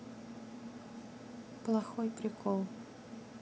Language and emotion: Russian, neutral